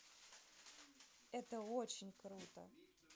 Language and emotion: Russian, neutral